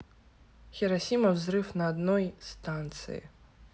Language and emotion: Russian, neutral